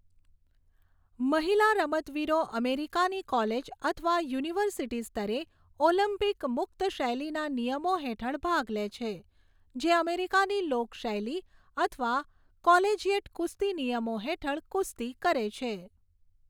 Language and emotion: Gujarati, neutral